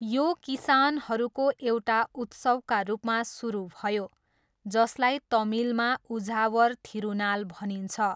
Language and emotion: Nepali, neutral